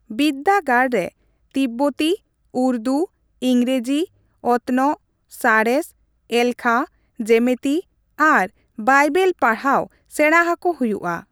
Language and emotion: Santali, neutral